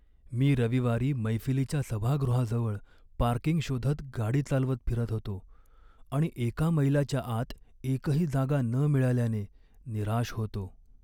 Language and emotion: Marathi, sad